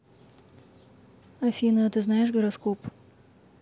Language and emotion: Russian, neutral